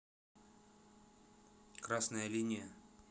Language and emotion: Russian, neutral